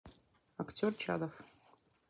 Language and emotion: Russian, neutral